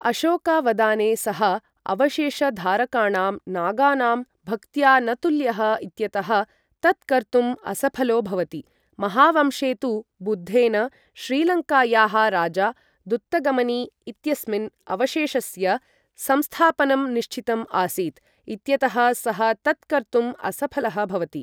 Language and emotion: Sanskrit, neutral